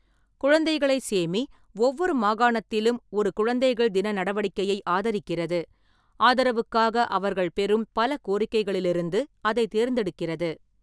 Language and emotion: Tamil, neutral